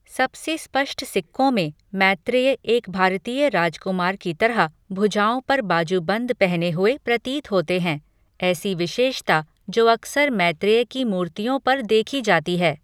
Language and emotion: Hindi, neutral